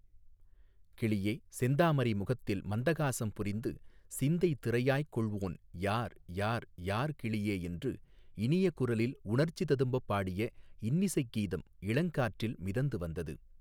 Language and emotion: Tamil, neutral